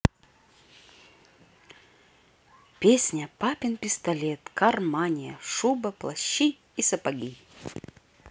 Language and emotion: Russian, positive